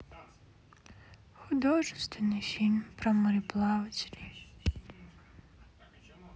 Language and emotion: Russian, sad